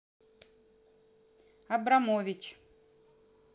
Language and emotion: Russian, neutral